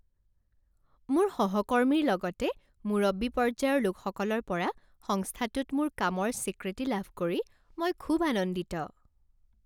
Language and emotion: Assamese, happy